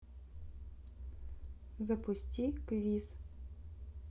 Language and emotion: Russian, neutral